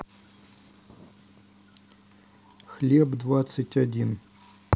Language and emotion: Russian, neutral